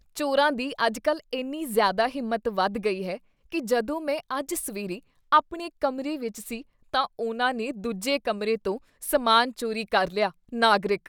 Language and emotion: Punjabi, disgusted